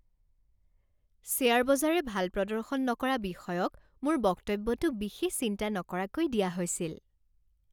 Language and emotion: Assamese, happy